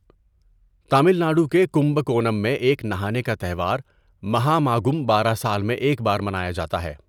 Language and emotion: Urdu, neutral